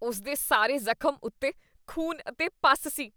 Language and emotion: Punjabi, disgusted